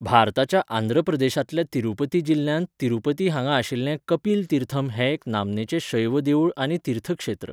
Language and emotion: Goan Konkani, neutral